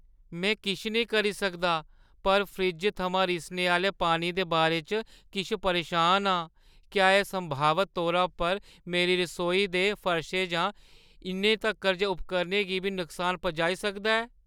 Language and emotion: Dogri, fearful